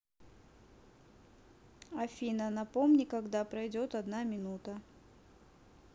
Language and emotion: Russian, neutral